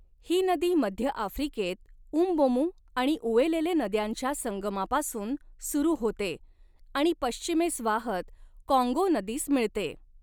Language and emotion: Marathi, neutral